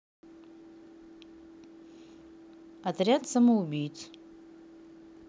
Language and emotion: Russian, neutral